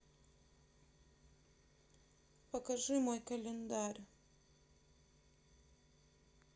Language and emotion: Russian, sad